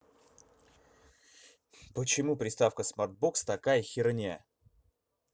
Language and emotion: Russian, angry